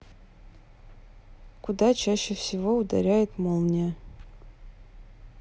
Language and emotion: Russian, neutral